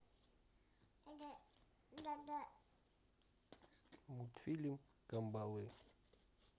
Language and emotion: Russian, neutral